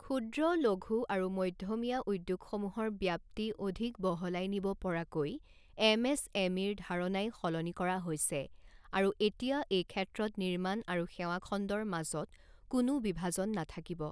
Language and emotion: Assamese, neutral